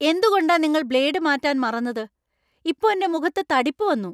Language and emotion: Malayalam, angry